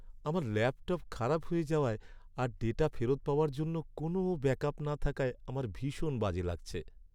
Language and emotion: Bengali, sad